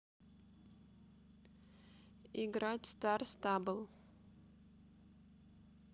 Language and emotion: Russian, neutral